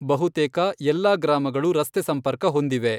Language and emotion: Kannada, neutral